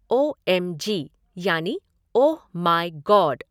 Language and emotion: Hindi, neutral